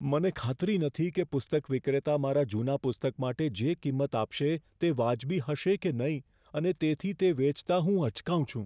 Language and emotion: Gujarati, fearful